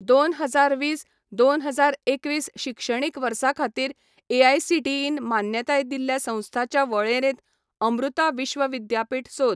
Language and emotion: Goan Konkani, neutral